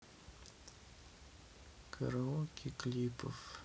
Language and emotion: Russian, sad